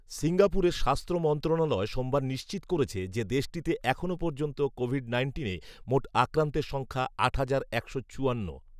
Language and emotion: Bengali, neutral